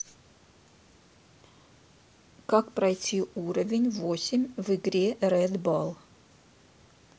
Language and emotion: Russian, neutral